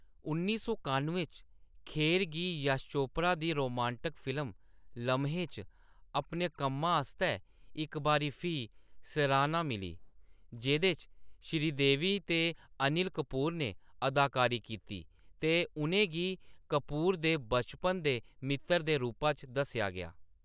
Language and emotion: Dogri, neutral